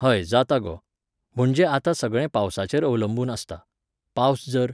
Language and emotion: Goan Konkani, neutral